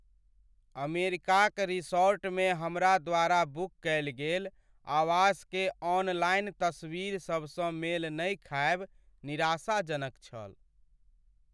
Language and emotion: Maithili, sad